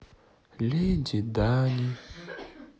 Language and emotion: Russian, sad